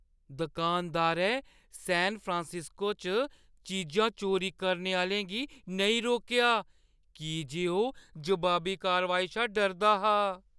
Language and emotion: Dogri, fearful